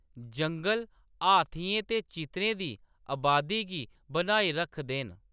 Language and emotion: Dogri, neutral